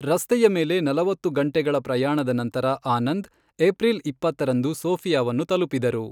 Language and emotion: Kannada, neutral